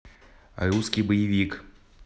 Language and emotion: Russian, neutral